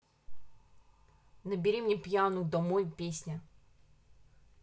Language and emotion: Russian, angry